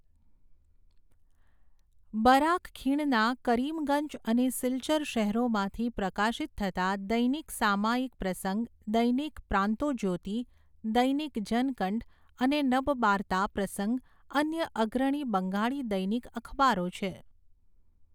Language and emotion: Gujarati, neutral